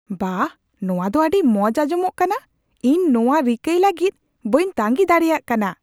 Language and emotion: Santali, surprised